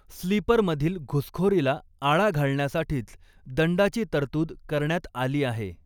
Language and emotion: Marathi, neutral